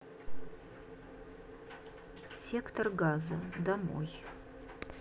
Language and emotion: Russian, neutral